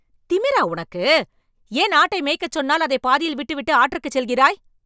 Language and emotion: Tamil, angry